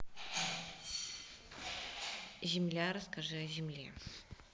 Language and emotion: Russian, neutral